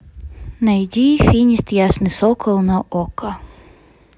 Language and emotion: Russian, neutral